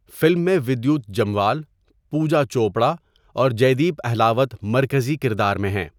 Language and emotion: Urdu, neutral